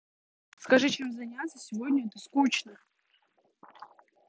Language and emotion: Russian, angry